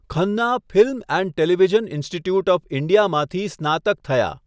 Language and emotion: Gujarati, neutral